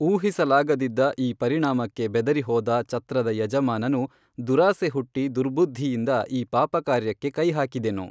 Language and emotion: Kannada, neutral